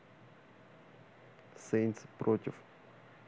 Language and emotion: Russian, neutral